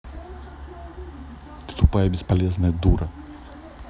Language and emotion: Russian, angry